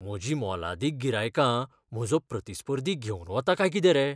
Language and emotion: Goan Konkani, fearful